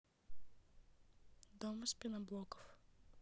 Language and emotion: Russian, neutral